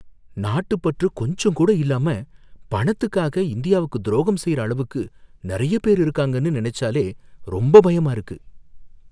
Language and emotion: Tamil, fearful